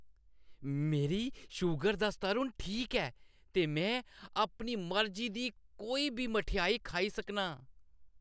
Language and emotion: Dogri, happy